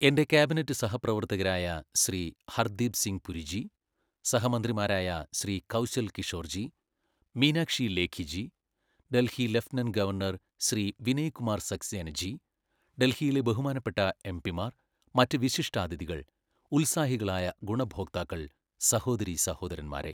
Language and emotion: Malayalam, neutral